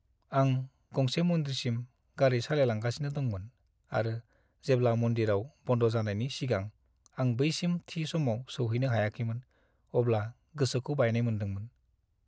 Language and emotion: Bodo, sad